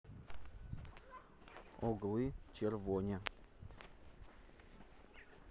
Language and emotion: Russian, neutral